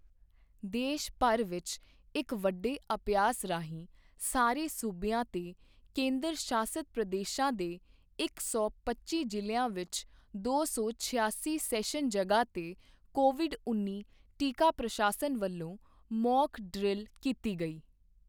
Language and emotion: Punjabi, neutral